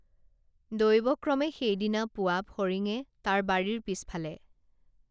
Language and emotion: Assamese, neutral